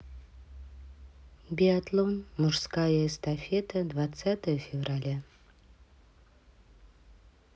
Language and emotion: Russian, neutral